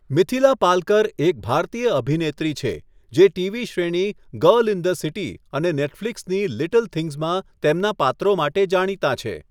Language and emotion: Gujarati, neutral